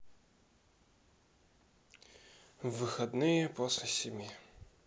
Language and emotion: Russian, sad